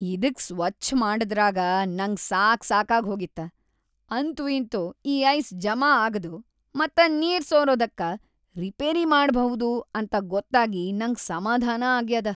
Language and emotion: Kannada, happy